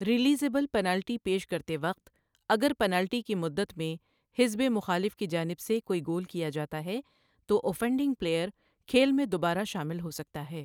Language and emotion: Urdu, neutral